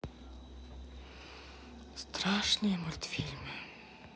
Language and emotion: Russian, sad